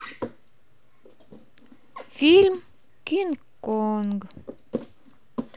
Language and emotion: Russian, neutral